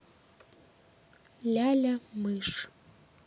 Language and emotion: Russian, neutral